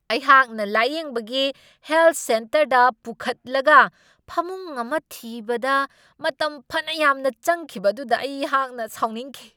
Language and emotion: Manipuri, angry